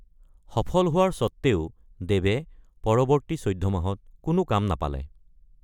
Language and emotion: Assamese, neutral